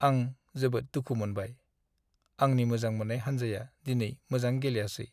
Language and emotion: Bodo, sad